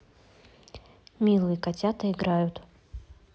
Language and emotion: Russian, neutral